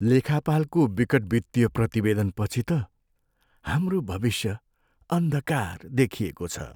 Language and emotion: Nepali, sad